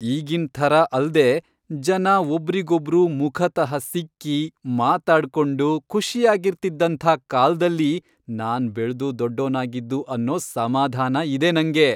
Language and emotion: Kannada, happy